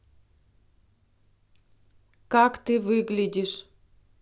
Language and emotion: Russian, neutral